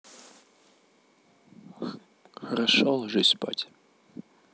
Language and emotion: Russian, neutral